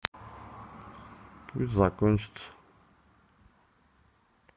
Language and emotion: Russian, neutral